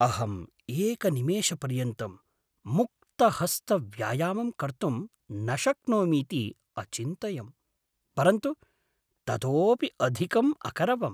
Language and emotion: Sanskrit, surprised